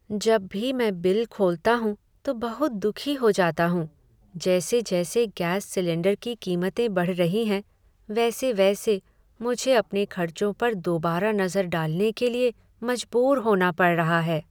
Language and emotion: Hindi, sad